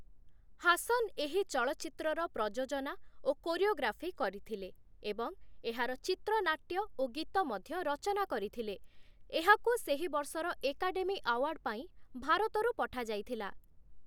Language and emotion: Odia, neutral